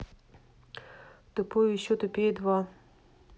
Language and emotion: Russian, neutral